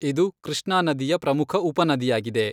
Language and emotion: Kannada, neutral